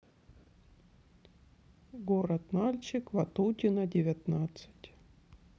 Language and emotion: Russian, neutral